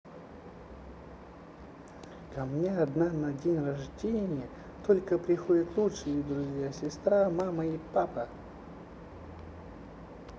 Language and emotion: Russian, neutral